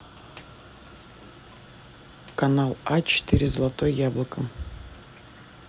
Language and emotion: Russian, neutral